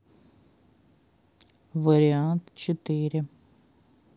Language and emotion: Russian, neutral